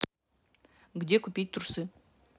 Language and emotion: Russian, neutral